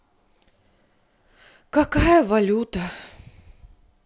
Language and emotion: Russian, sad